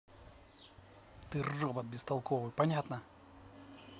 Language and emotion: Russian, angry